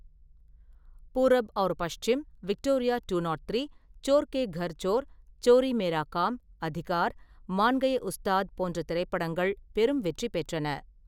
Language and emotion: Tamil, neutral